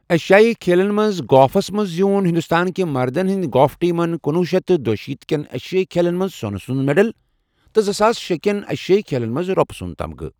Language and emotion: Kashmiri, neutral